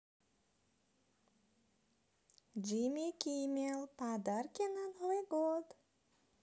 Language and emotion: Russian, positive